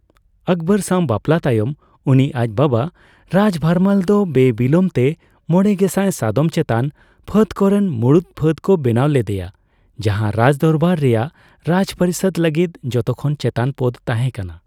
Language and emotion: Santali, neutral